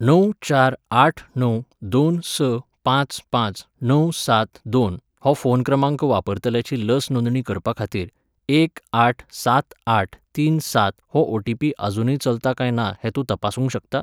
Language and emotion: Goan Konkani, neutral